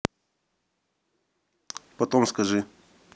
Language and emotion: Russian, neutral